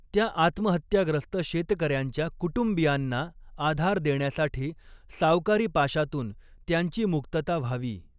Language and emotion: Marathi, neutral